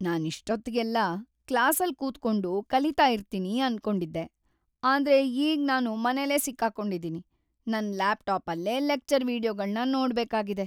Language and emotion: Kannada, sad